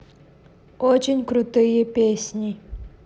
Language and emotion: Russian, neutral